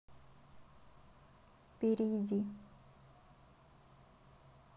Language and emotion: Russian, neutral